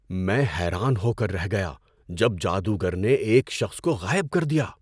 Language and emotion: Urdu, surprised